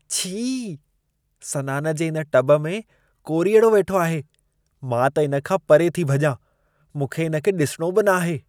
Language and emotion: Sindhi, disgusted